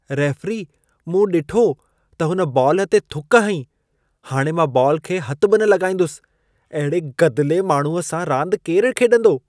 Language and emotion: Sindhi, disgusted